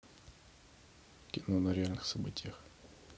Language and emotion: Russian, neutral